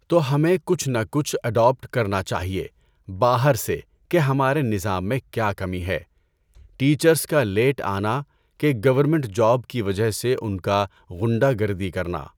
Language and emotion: Urdu, neutral